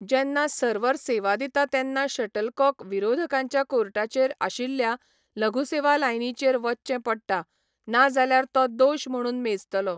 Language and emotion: Goan Konkani, neutral